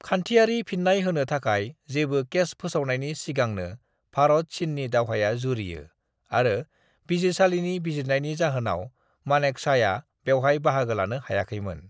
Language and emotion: Bodo, neutral